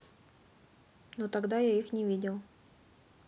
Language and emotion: Russian, neutral